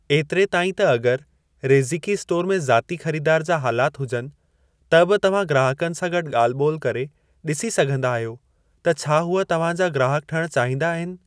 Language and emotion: Sindhi, neutral